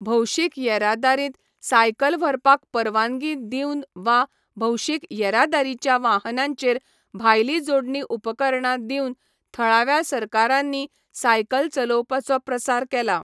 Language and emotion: Goan Konkani, neutral